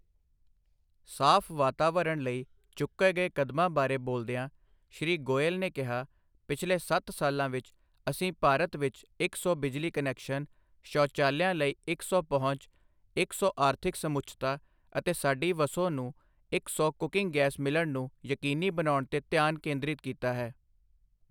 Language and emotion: Punjabi, neutral